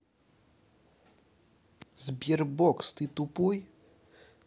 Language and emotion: Russian, angry